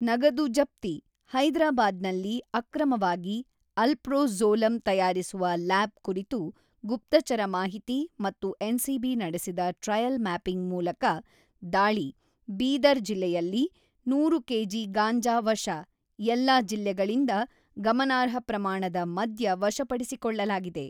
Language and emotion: Kannada, neutral